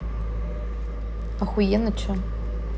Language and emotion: Russian, neutral